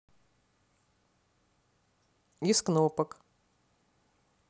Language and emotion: Russian, neutral